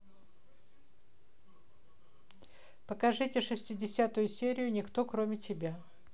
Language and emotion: Russian, neutral